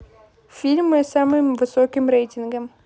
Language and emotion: Russian, neutral